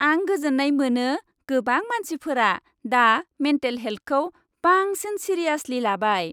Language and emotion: Bodo, happy